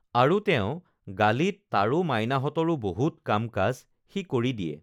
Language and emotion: Assamese, neutral